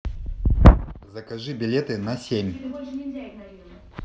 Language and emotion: Russian, neutral